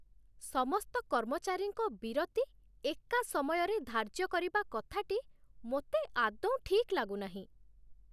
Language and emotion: Odia, disgusted